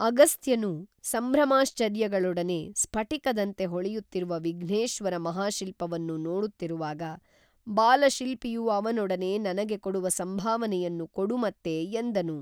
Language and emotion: Kannada, neutral